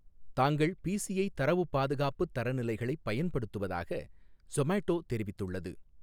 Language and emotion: Tamil, neutral